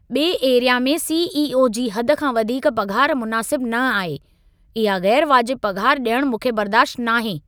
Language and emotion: Sindhi, angry